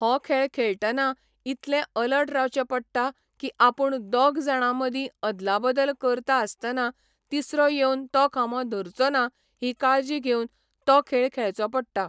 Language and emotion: Goan Konkani, neutral